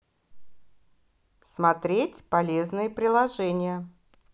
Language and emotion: Russian, positive